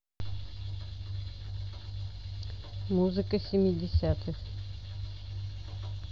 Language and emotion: Russian, neutral